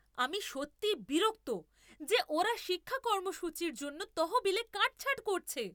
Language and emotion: Bengali, angry